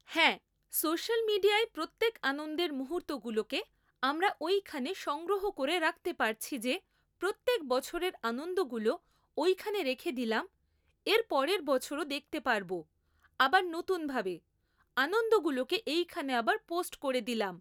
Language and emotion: Bengali, neutral